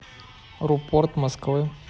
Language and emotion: Russian, neutral